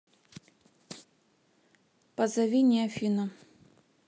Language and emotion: Russian, neutral